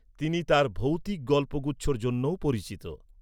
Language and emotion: Bengali, neutral